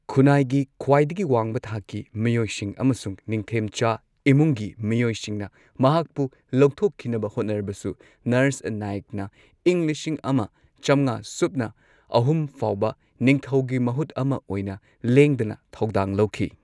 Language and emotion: Manipuri, neutral